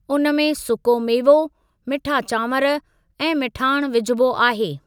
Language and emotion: Sindhi, neutral